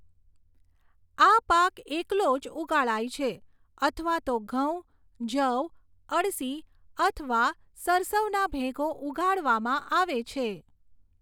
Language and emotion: Gujarati, neutral